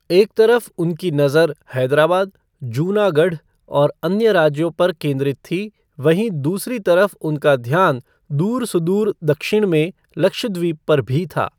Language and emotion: Hindi, neutral